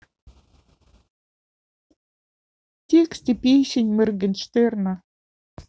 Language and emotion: Russian, sad